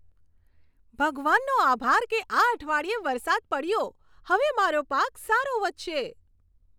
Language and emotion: Gujarati, happy